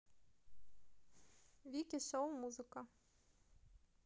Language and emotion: Russian, neutral